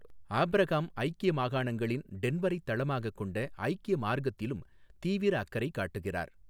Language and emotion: Tamil, neutral